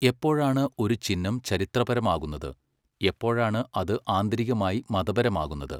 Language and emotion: Malayalam, neutral